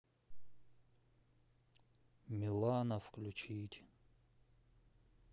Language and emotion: Russian, sad